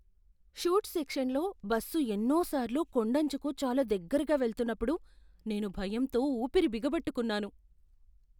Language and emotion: Telugu, fearful